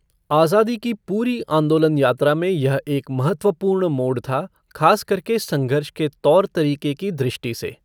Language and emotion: Hindi, neutral